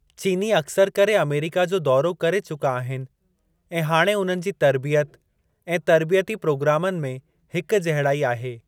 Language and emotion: Sindhi, neutral